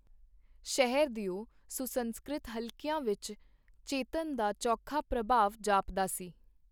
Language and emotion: Punjabi, neutral